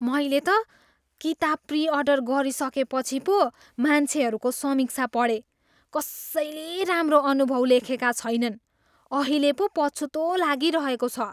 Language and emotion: Nepali, disgusted